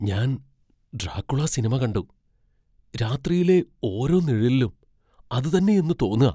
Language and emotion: Malayalam, fearful